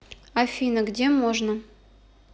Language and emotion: Russian, neutral